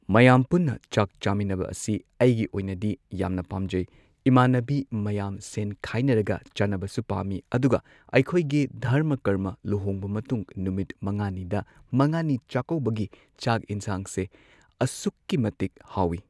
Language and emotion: Manipuri, neutral